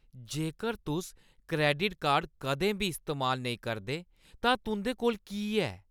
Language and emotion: Dogri, disgusted